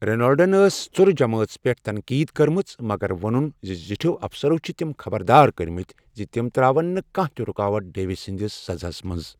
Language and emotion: Kashmiri, neutral